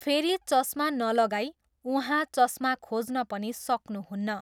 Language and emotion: Nepali, neutral